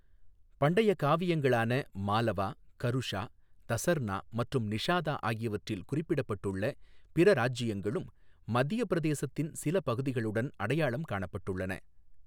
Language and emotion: Tamil, neutral